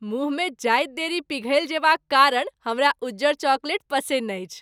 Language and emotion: Maithili, happy